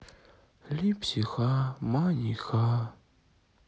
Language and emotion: Russian, sad